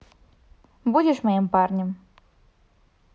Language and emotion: Russian, neutral